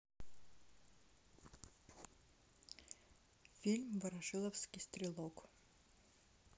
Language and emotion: Russian, neutral